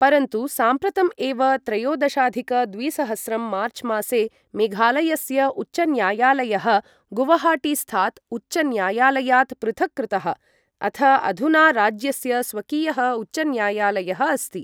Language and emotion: Sanskrit, neutral